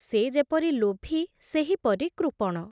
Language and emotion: Odia, neutral